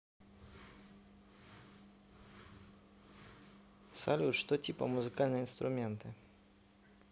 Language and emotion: Russian, neutral